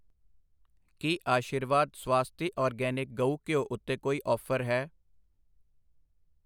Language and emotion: Punjabi, neutral